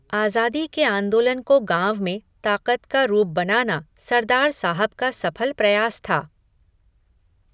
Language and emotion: Hindi, neutral